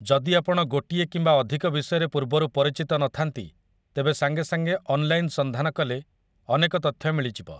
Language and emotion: Odia, neutral